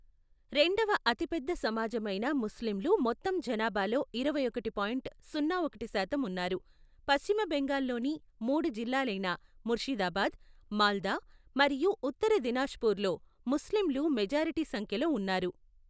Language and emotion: Telugu, neutral